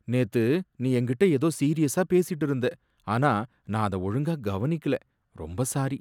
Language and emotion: Tamil, sad